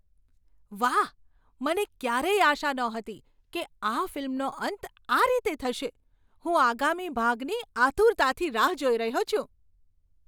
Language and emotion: Gujarati, surprised